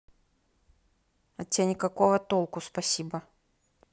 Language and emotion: Russian, neutral